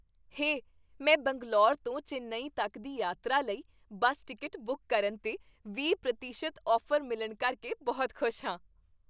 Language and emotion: Punjabi, happy